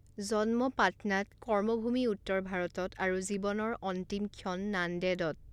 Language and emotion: Assamese, neutral